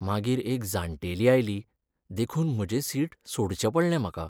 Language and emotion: Goan Konkani, sad